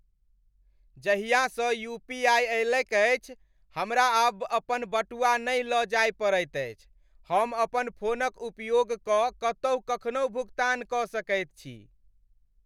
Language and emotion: Maithili, happy